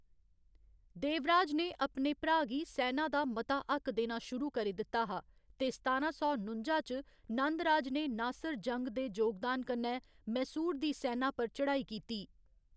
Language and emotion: Dogri, neutral